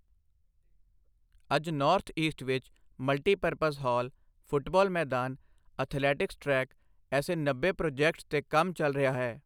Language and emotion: Punjabi, neutral